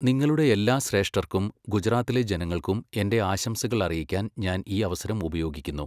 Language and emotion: Malayalam, neutral